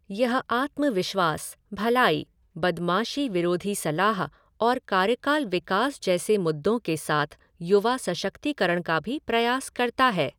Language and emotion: Hindi, neutral